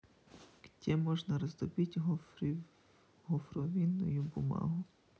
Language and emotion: Russian, neutral